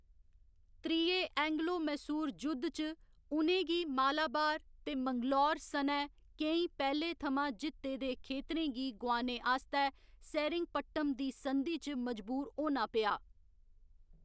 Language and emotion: Dogri, neutral